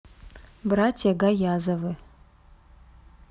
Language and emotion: Russian, neutral